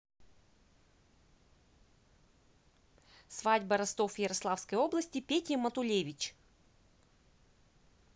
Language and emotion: Russian, neutral